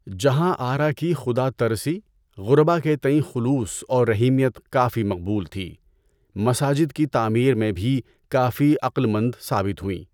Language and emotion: Urdu, neutral